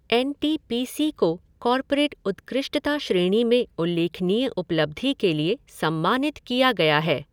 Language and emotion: Hindi, neutral